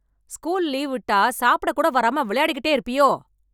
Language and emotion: Tamil, angry